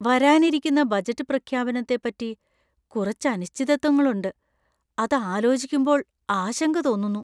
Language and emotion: Malayalam, fearful